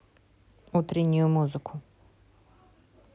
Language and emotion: Russian, neutral